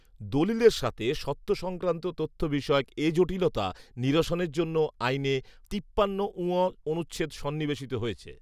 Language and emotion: Bengali, neutral